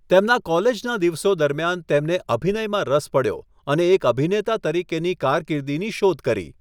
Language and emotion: Gujarati, neutral